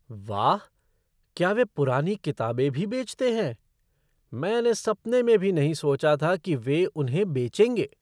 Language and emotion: Hindi, surprised